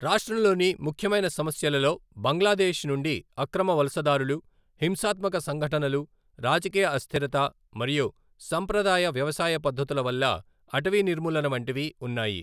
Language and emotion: Telugu, neutral